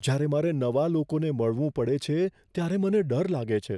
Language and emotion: Gujarati, fearful